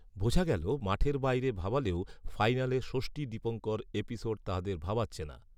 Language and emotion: Bengali, neutral